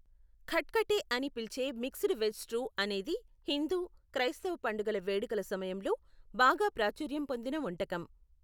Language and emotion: Telugu, neutral